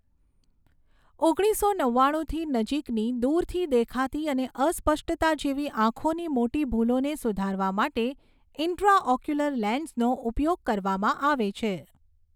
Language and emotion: Gujarati, neutral